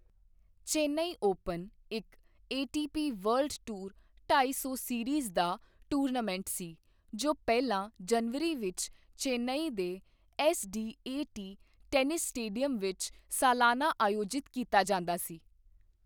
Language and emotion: Punjabi, neutral